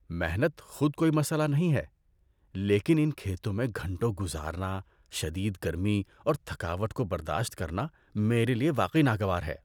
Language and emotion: Urdu, disgusted